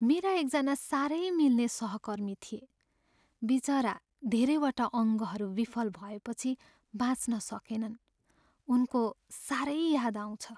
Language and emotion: Nepali, sad